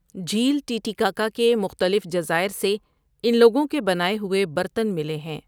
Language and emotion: Urdu, neutral